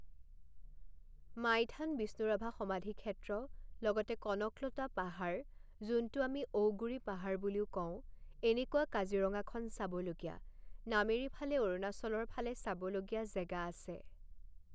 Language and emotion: Assamese, neutral